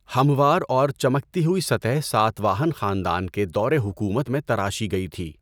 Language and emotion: Urdu, neutral